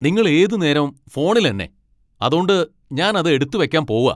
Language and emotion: Malayalam, angry